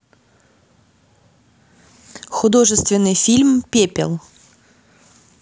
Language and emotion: Russian, neutral